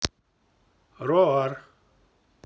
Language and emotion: Russian, neutral